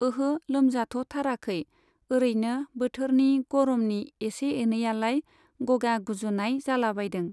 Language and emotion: Bodo, neutral